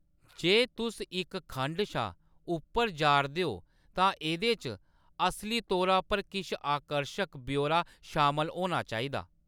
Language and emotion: Dogri, neutral